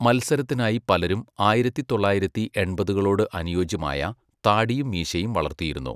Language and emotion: Malayalam, neutral